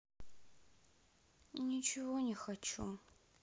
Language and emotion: Russian, sad